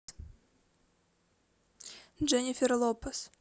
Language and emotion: Russian, neutral